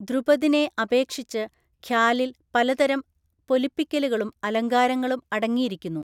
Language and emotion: Malayalam, neutral